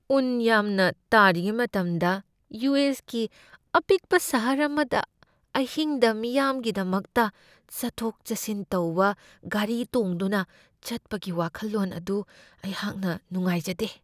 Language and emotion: Manipuri, fearful